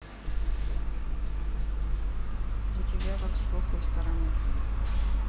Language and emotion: Russian, sad